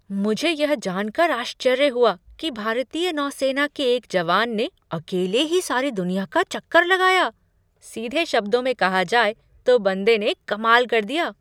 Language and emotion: Hindi, surprised